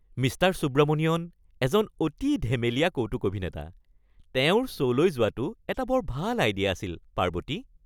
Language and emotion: Assamese, happy